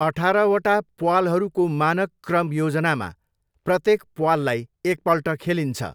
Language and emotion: Nepali, neutral